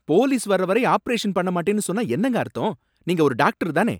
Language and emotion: Tamil, angry